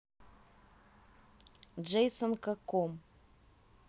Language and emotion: Russian, neutral